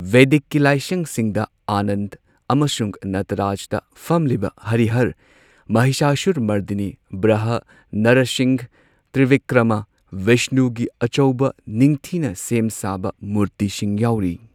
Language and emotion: Manipuri, neutral